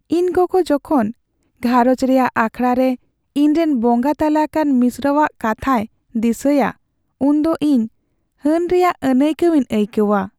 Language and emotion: Santali, sad